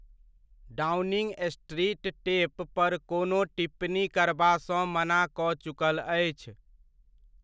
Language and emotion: Maithili, neutral